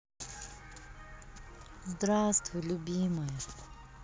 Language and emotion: Russian, positive